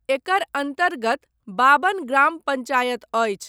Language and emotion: Maithili, neutral